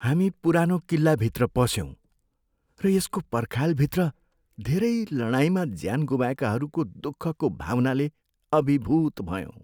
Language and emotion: Nepali, sad